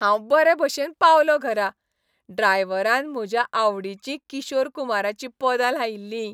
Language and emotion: Goan Konkani, happy